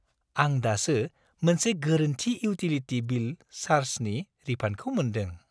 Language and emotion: Bodo, happy